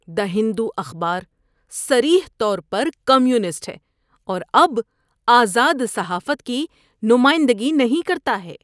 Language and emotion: Urdu, disgusted